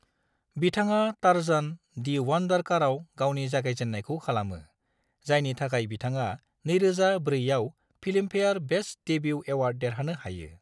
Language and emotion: Bodo, neutral